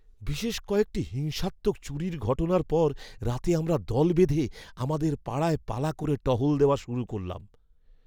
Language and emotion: Bengali, fearful